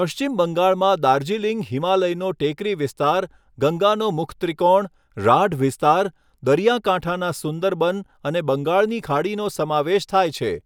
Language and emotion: Gujarati, neutral